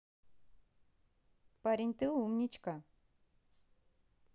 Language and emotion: Russian, positive